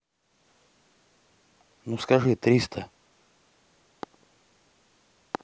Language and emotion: Russian, neutral